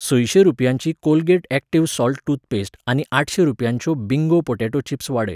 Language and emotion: Goan Konkani, neutral